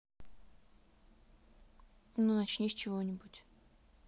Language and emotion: Russian, neutral